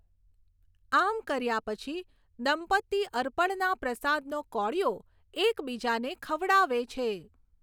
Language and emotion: Gujarati, neutral